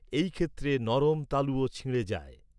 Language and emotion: Bengali, neutral